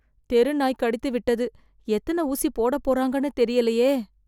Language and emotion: Tamil, fearful